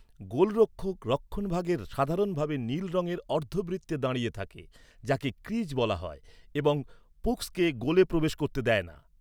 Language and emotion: Bengali, neutral